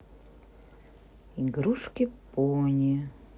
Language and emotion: Russian, neutral